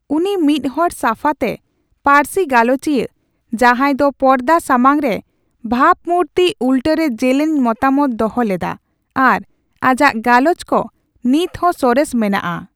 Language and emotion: Santali, neutral